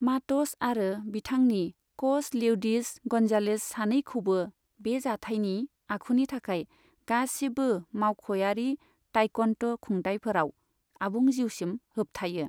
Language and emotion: Bodo, neutral